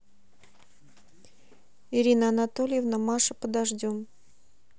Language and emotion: Russian, neutral